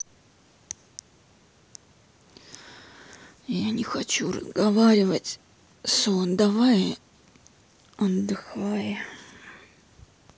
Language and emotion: Russian, sad